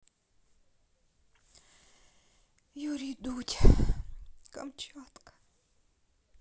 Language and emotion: Russian, sad